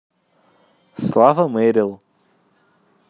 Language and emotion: Russian, positive